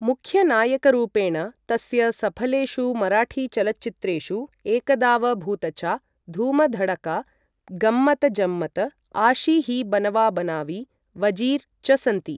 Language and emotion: Sanskrit, neutral